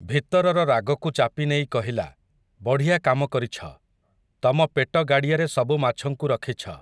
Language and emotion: Odia, neutral